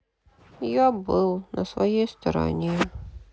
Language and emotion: Russian, sad